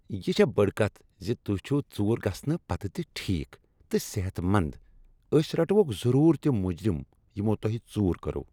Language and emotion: Kashmiri, happy